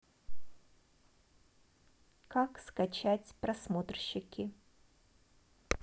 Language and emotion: Russian, neutral